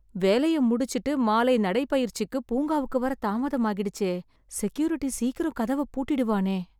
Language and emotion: Tamil, fearful